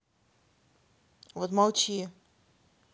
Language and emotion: Russian, angry